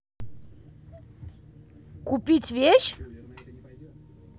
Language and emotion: Russian, angry